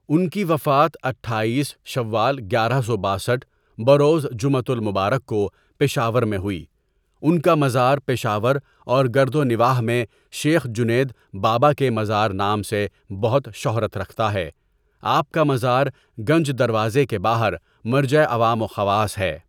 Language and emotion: Urdu, neutral